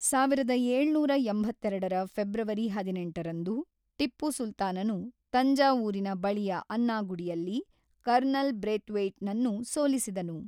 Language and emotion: Kannada, neutral